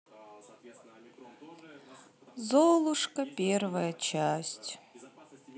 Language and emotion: Russian, sad